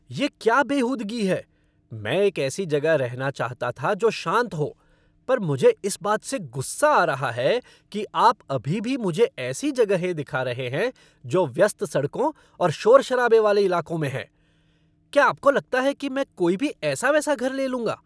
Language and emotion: Hindi, angry